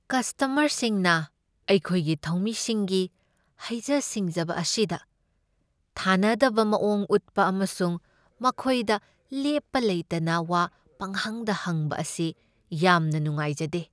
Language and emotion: Manipuri, sad